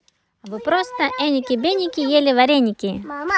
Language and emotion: Russian, positive